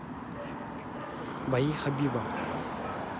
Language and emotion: Russian, neutral